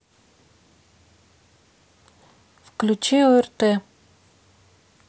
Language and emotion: Russian, neutral